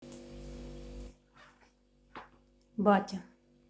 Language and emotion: Russian, neutral